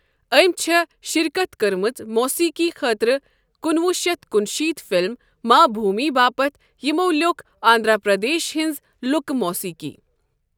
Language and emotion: Kashmiri, neutral